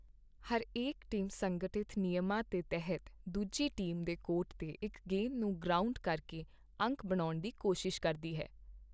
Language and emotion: Punjabi, neutral